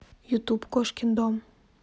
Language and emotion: Russian, neutral